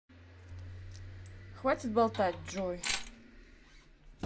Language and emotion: Russian, neutral